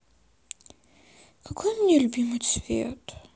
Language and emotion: Russian, sad